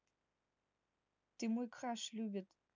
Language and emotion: Russian, neutral